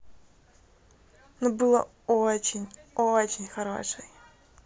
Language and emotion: Russian, positive